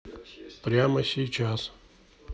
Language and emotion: Russian, neutral